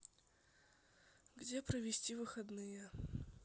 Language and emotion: Russian, sad